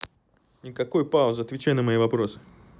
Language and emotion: Russian, angry